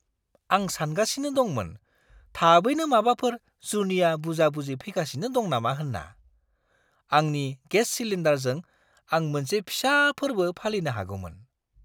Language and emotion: Bodo, surprised